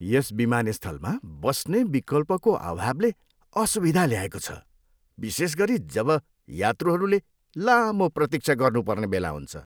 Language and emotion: Nepali, disgusted